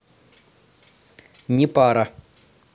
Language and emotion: Russian, neutral